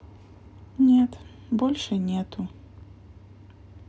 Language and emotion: Russian, sad